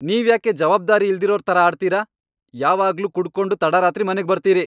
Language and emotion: Kannada, angry